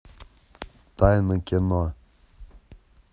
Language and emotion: Russian, neutral